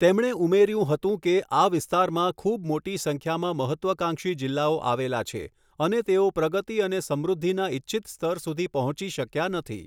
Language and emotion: Gujarati, neutral